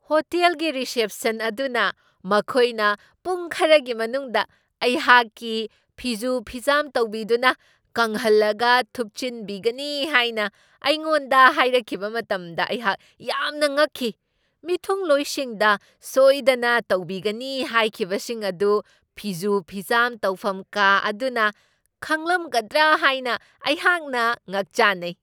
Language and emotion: Manipuri, surprised